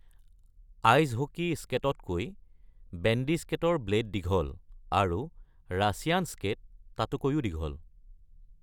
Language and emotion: Assamese, neutral